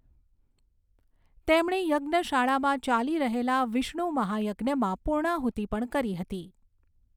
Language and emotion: Gujarati, neutral